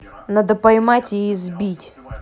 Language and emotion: Russian, angry